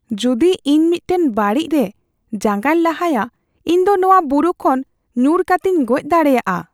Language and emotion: Santali, fearful